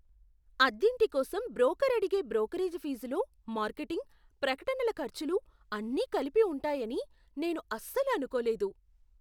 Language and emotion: Telugu, surprised